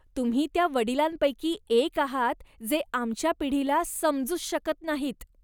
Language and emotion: Marathi, disgusted